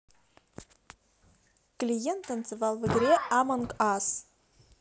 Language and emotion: Russian, neutral